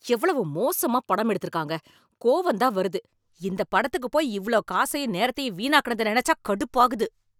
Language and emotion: Tamil, angry